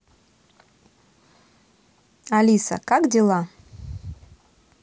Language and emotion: Russian, neutral